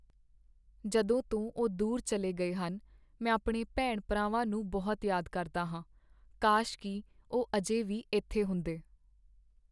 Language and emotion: Punjabi, sad